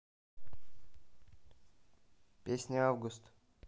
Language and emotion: Russian, neutral